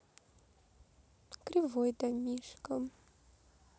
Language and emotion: Russian, neutral